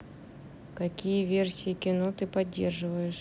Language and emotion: Russian, neutral